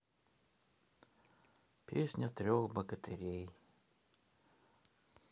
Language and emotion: Russian, sad